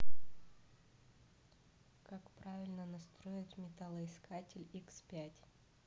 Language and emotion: Russian, neutral